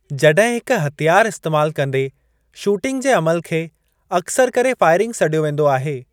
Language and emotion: Sindhi, neutral